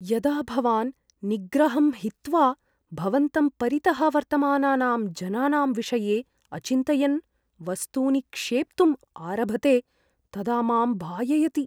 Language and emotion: Sanskrit, fearful